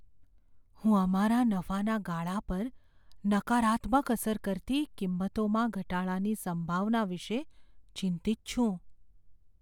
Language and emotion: Gujarati, fearful